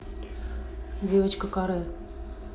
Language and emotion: Russian, neutral